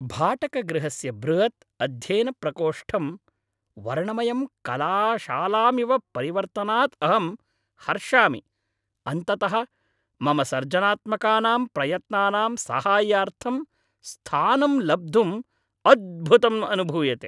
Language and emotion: Sanskrit, happy